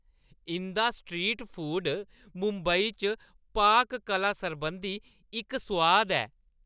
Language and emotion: Dogri, happy